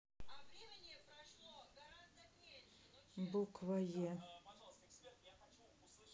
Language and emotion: Russian, neutral